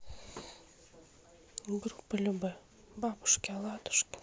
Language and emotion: Russian, sad